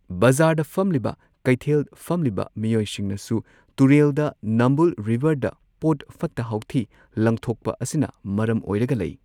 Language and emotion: Manipuri, neutral